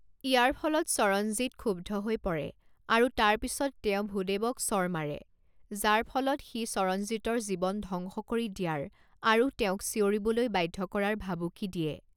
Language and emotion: Assamese, neutral